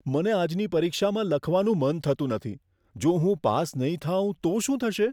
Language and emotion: Gujarati, fearful